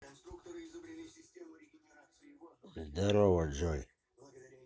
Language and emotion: Russian, neutral